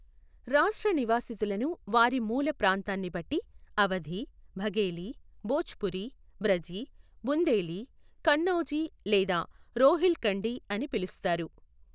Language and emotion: Telugu, neutral